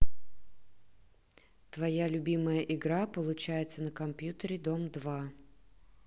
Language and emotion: Russian, neutral